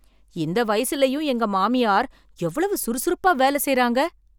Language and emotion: Tamil, surprised